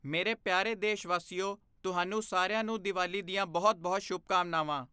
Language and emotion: Punjabi, neutral